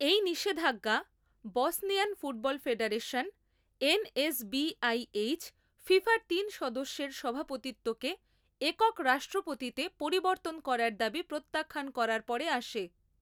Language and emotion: Bengali, neutral